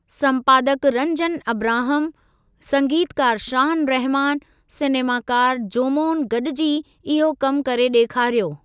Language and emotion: Sindhi, neutral